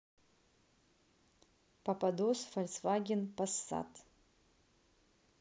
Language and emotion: Russian, neutral